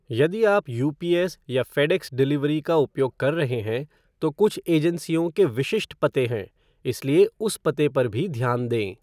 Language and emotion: Hindi, neutral